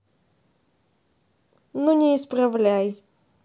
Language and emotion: Russian, neutral